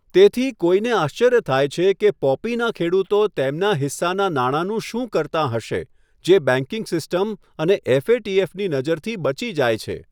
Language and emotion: Gujarati, neutral